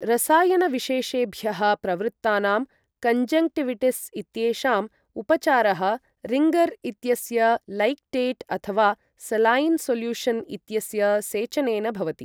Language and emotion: Sanskrit, neutral